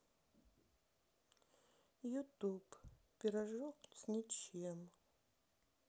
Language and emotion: Russian, sad